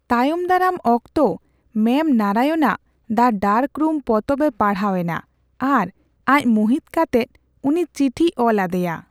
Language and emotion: Santali, neutral